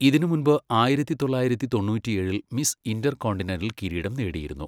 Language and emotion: Malayalam, neutral